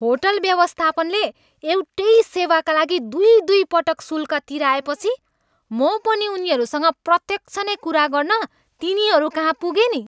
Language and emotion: Nepali, angry